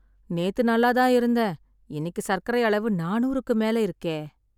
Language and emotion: Tamil, sad